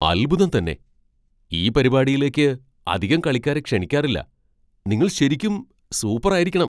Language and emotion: Malayalam, surprised